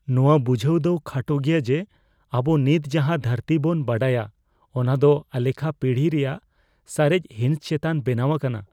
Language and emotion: Santali, fearful